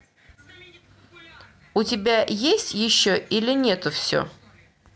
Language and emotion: Russian, neutral